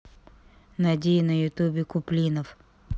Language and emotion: Russian, neutral